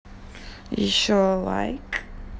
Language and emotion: Russian, neutral